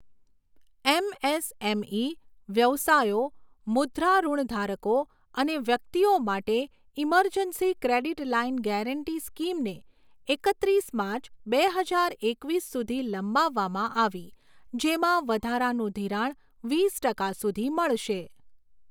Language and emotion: Gujarati, neutral